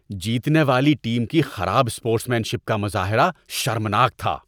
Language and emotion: Urdu, disgusted